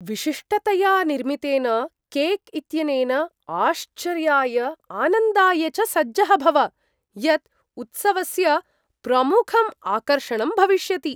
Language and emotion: Sanskrit, surprised